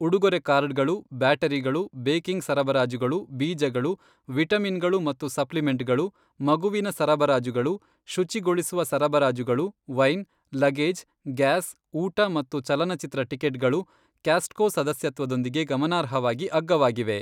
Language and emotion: Kannada, neutral